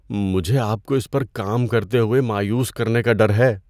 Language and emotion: Urdu, fearful